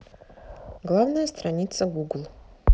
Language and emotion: Russian, neutral